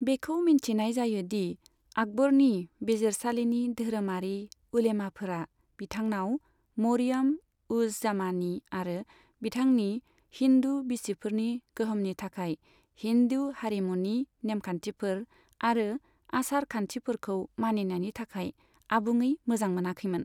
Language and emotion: Bodo, neutral